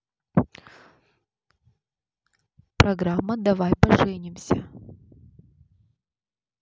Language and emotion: Russian, neutral